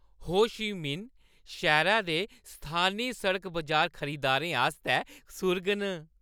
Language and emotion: Dogri, happy